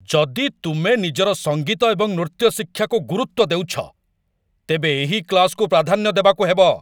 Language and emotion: Odia, angry